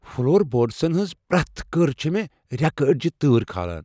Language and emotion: Kashmiri, fearful